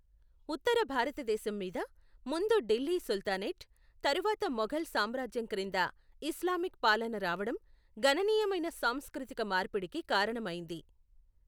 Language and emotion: Telugu, neutral